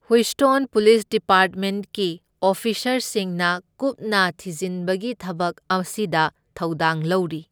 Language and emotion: Manipuri, neutral